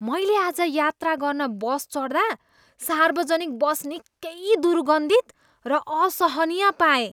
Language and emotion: Nepali, disgusted